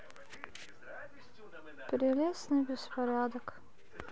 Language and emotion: Russian, sad